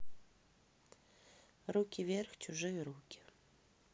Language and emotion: Russian, neutral